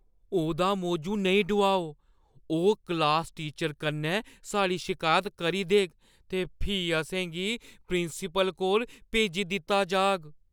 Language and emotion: Dogri, fearful